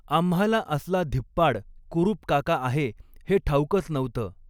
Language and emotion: Marathi, neutral